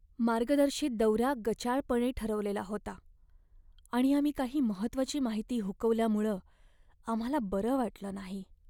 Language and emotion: Marathi, sad